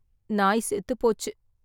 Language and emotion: Tamil, sad